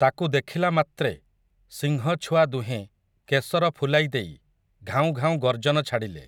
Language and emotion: Odia, neutral